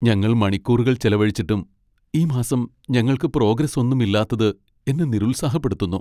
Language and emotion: Malayalam, sad